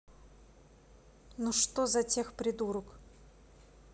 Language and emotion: Russian, angry